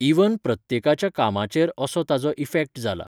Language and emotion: Goan Konkani, neutral